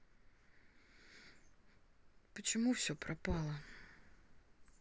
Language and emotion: Russian, sad